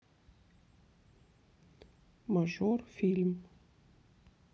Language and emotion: Russian, neutral